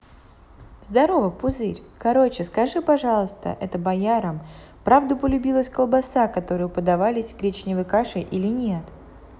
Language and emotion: Russian, positive